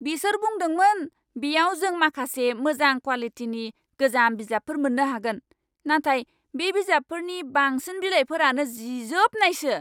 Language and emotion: Bodo, angry